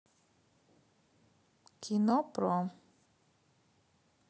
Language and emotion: Russian, neutral